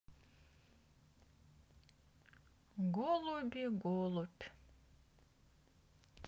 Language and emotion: Russian, sad